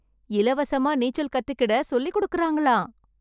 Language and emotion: Tamil, happy